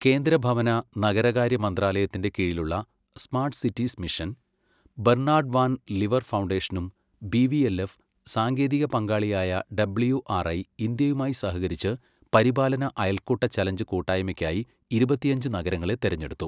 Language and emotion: Malayalam, neutral